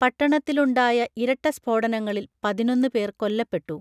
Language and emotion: Malayalam, neutral